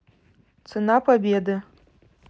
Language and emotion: Russian, neutral